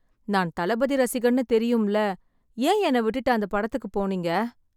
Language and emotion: Tamil, sad